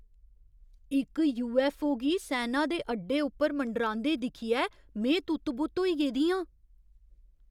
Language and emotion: Dogri, surprised